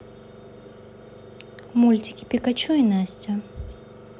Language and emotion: Russian, neutral